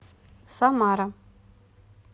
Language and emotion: Russian, neutral